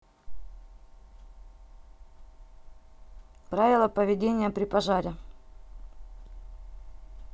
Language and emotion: Russian, neutral